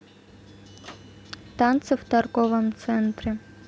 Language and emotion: Russian, neutral